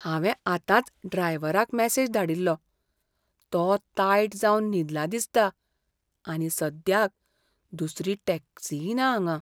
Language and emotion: Goan Konkani, fearful